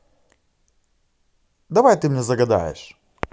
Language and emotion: Russian, positive